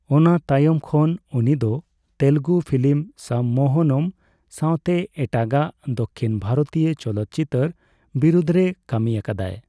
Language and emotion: Santali, neutral